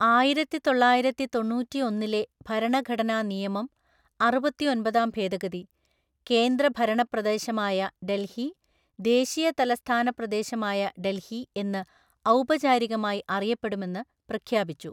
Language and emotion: Malayalam, neutral